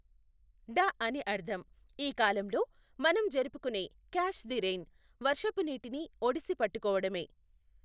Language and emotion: Telugu, neutral